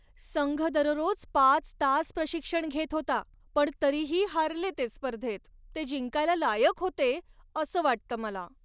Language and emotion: Marathi, sad